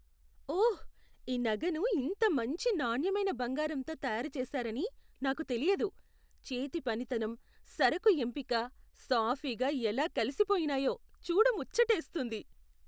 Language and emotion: Telugu, surprised